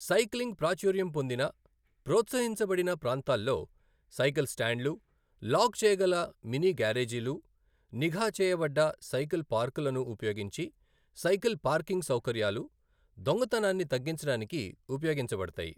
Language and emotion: Telugu, neutral